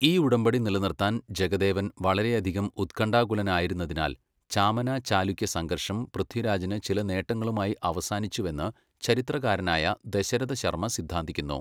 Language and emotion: Malayalam, neutral